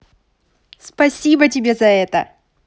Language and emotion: Russian, positive